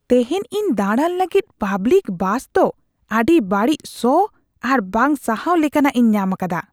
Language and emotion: Santali, disgusted